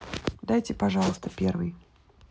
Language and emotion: Russian, neutral